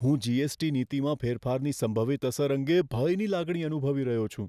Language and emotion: Gujarati, fearful